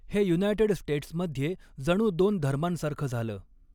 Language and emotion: Marathi, neutral